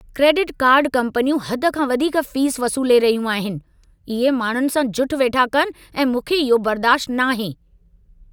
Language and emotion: Sindhi, angry